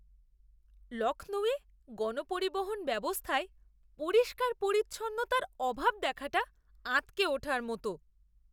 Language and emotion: Bengali, disgusted